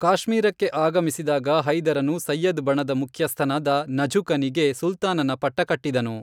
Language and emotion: Kannada, neutral